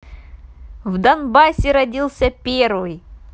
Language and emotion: Russian, positive